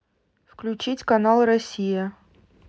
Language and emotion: Russian, neutral